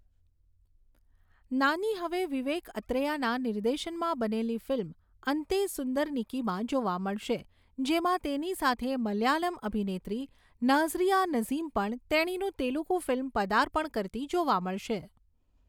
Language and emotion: Gujarati, neutral